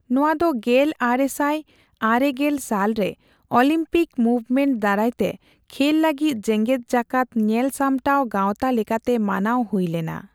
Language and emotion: Santali, neutral